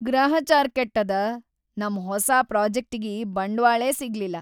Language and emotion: Kannada, sad